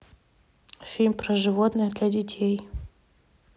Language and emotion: Russian, neutral